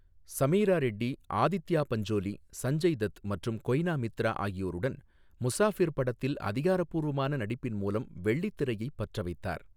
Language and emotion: Tamil, neutral